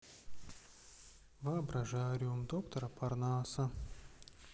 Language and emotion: Russian, sad